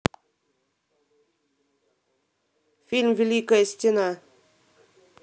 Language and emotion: Russian, neutral